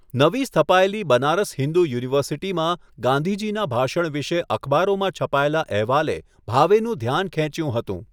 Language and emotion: Gujarati, neutral